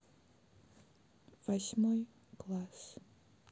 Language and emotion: Russian, sad